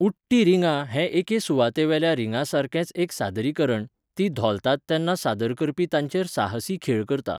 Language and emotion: Goan Konkani, neutral